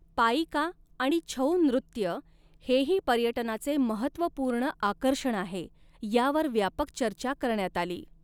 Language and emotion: Marathi, neutral